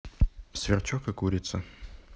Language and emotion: Russian, neutral